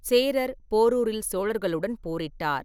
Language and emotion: Tamil, neutral